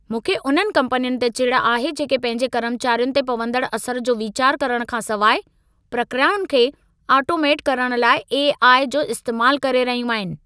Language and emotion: Sindhi, angry